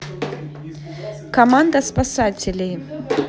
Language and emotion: Russian, neutral